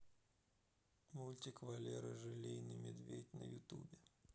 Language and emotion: Russian, sad